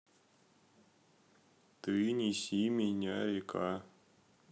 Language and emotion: Russian, sad